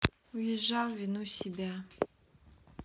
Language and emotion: Russian, sad